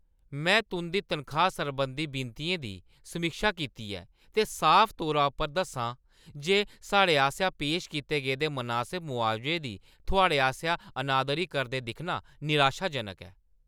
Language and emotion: Dogri, angry